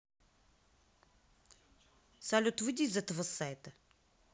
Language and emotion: Russian, neutral